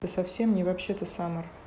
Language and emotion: Russian, neutral